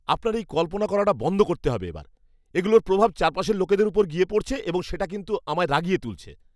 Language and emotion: Bengali, angry